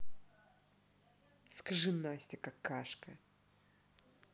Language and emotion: Russian, angry